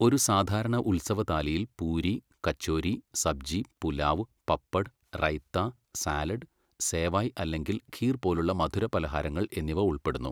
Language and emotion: Malayalam, neutral